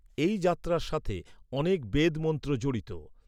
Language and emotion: Bengali, neutral